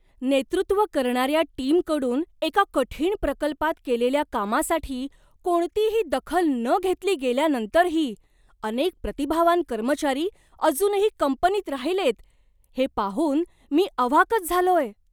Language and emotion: Marathi, surprised